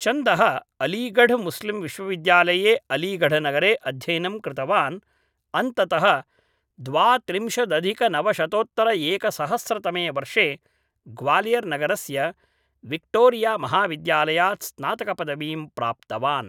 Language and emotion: Sanskrit, neutral